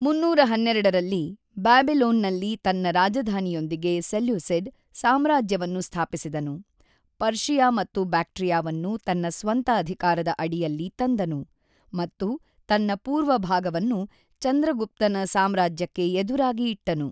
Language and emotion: Kannada, neutral